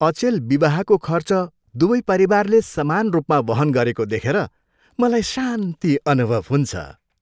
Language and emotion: Nepali, happy